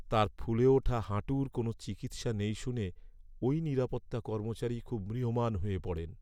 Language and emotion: Bengali, sad